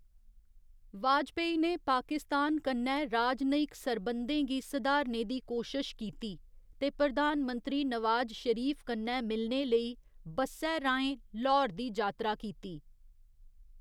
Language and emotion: Dogri, neutral